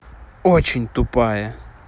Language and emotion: Russian, angry